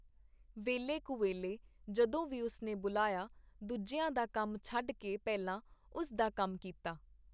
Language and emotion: Punjabi, neutral